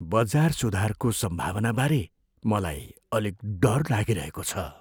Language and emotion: Nepali, fearful